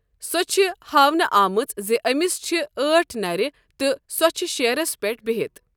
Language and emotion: Kashmiri, neutral